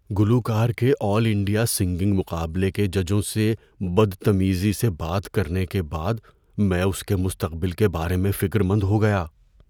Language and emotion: Urdu, fearful